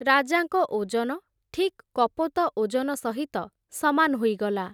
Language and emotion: Odia, neutral